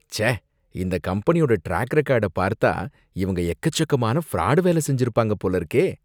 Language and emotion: Tamil, disgusted